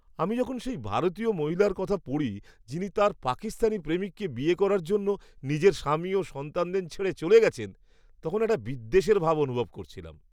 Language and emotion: Bengali, disgusted